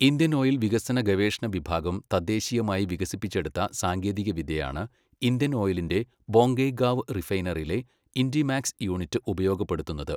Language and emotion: Malayalam, neutral